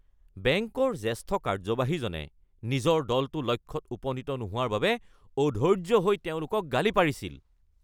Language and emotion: Assamese, angry